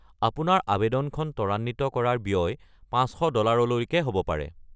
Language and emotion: Assamese, neutral